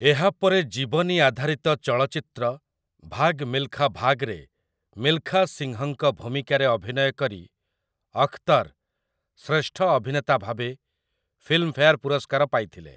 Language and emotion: Odia, neutral